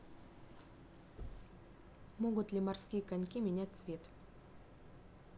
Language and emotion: Russian, neutral